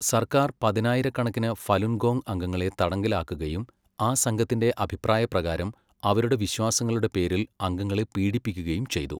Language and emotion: Malayalam, neutral